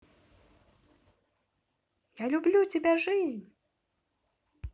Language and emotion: Russian, positive